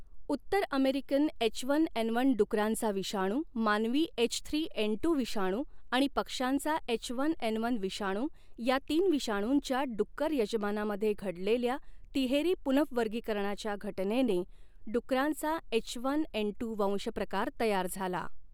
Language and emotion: Marathi, neutral